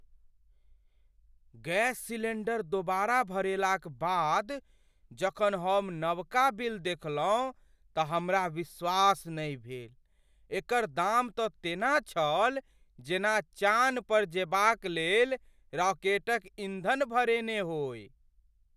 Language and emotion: Maithili, surprised